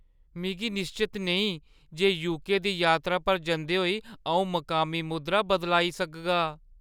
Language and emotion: Dogri, fearful